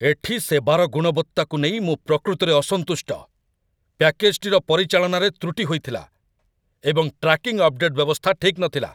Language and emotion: Odia, angry